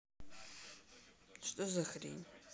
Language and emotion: Russian, neutral